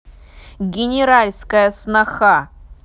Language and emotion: Russian, angry